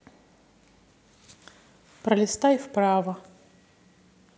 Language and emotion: Russian, neutral